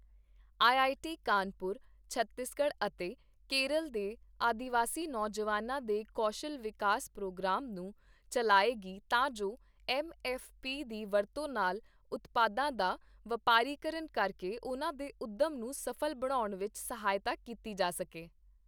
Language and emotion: Punjabi, neutral